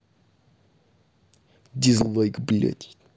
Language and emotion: Russian, angry